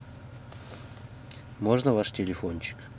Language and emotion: Russian, neutral